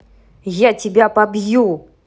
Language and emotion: Russian, angry